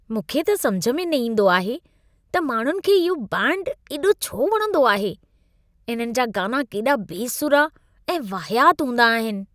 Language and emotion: Sindhi, disgusted